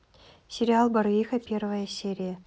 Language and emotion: Russian, neutral